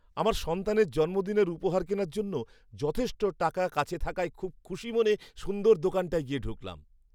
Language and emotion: Bengali, happy